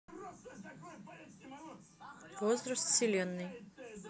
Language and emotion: Russian, neutral